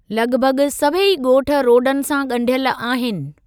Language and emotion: Sindhi, neutral